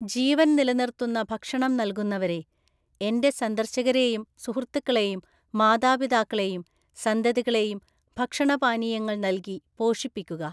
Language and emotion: Malayalam, neutral